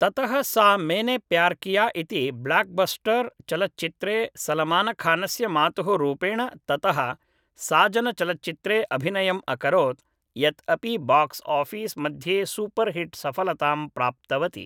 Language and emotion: Sanskrit, neutral